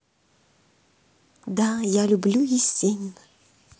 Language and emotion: Russian, positive